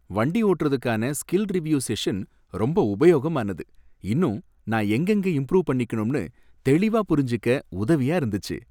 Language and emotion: Tamil, happy